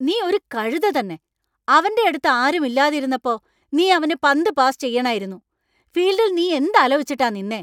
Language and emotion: Malayalam, angry